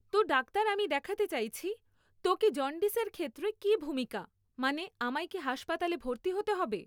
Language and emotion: Bengali, neutral